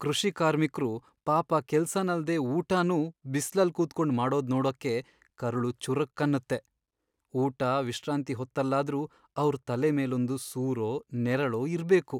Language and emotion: Kannada, sad